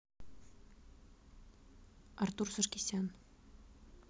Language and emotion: Russian, neutral